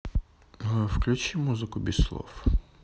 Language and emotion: Russian, neutral